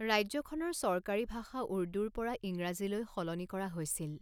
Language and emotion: Assamese, neutral